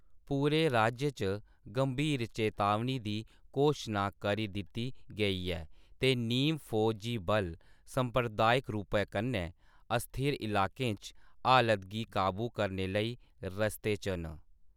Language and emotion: Dogri, neutral